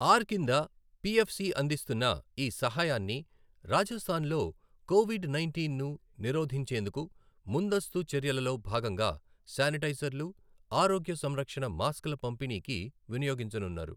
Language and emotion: Telugu, neutral